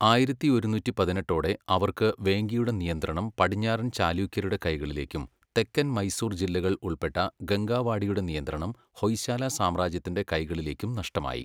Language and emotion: Malayalam, neutral